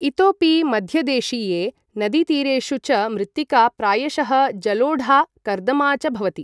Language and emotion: Sanskrit, neutral